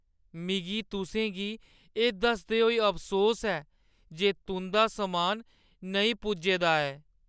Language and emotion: Dogri, sad